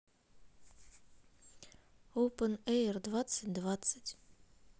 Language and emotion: Russian, neutral